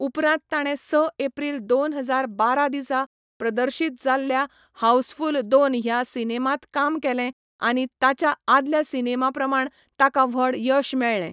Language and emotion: Goan Konkani, neutral